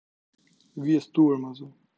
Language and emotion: Russian, neutral